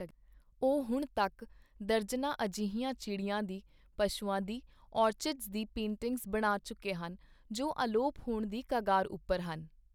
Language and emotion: Punjabi, neutral